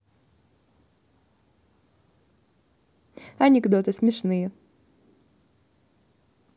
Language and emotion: Russian, positive